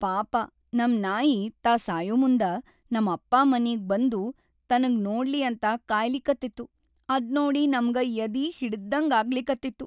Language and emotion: Kannada, sad